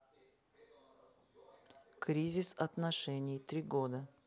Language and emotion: Russian, neutral